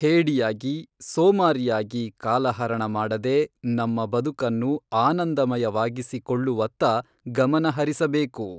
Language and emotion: Kannada, neutral